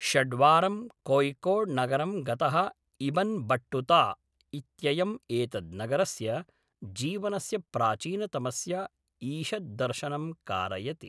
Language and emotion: Sanskrit, neutral